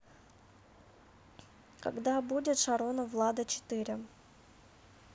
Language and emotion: Russian, neutral